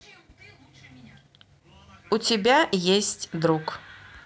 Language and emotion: Russian, neutral